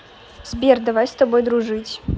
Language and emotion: Russian, neutral